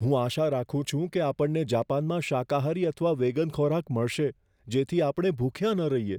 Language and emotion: Gujarati, fearful